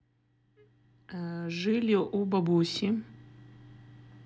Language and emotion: Russian, neutral